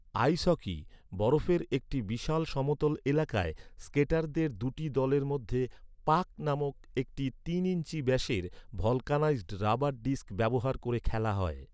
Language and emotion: Bengali, neutral